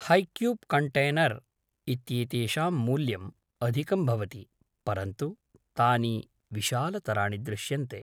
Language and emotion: Sanskrit, neutral